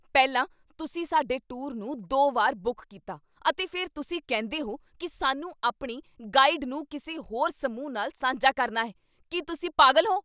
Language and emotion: Punjabi, angry